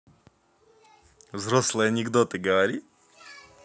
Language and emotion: Russian, positive